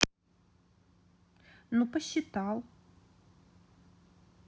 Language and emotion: Russian, neutral